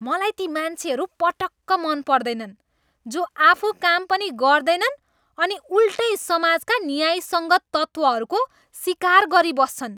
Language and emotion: Nepali, disgusted